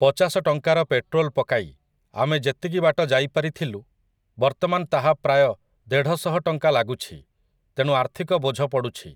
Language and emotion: Odia, neutral